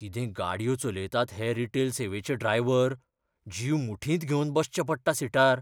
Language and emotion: Goan Konkani, fearful